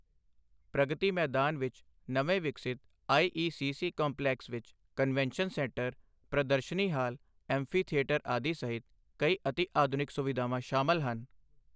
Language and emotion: Punjabi, neutral